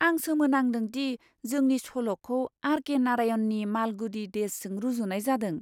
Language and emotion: Bodo, surprised